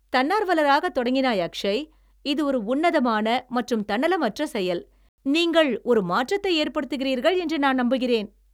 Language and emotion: Tamil, happy